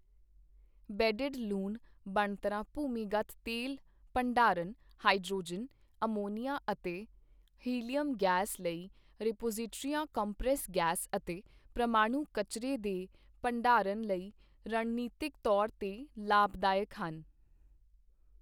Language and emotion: Punjabi, neutral